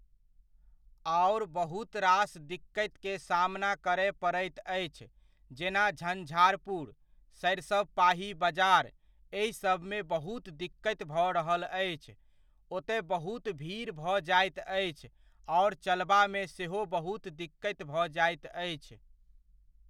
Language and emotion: Maithili, neutral